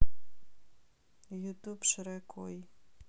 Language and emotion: Russian, sad